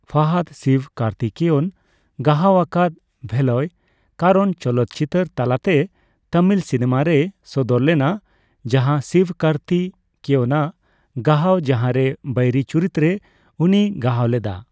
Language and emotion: Santali, neutral